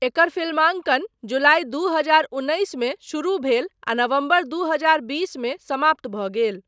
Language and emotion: Maithili, neutral